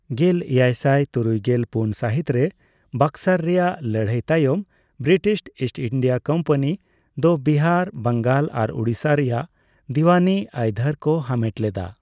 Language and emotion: Santali, neutral